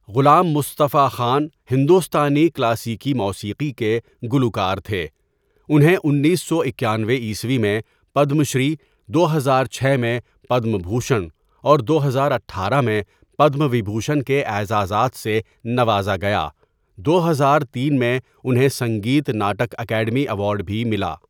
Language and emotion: Urdu, neutral